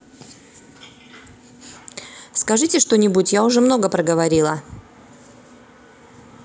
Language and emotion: Russian, neutral